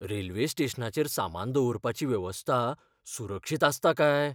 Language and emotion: Goan Konkani, fearful